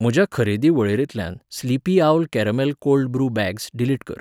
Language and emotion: Goan Konkani, neutral